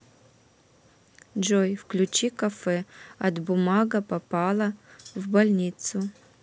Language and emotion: Russian, neutral